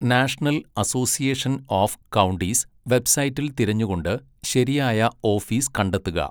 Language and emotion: Malayalam, neutral